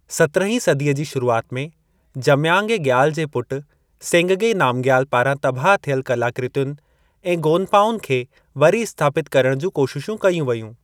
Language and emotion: Sindhi, neutral